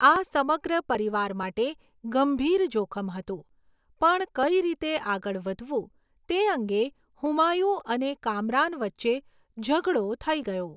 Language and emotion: Gujarati, neutral